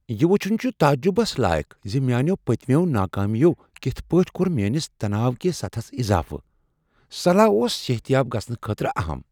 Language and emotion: Kashmiri, surprised